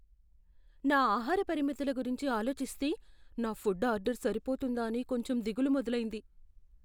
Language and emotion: Telugu, fearful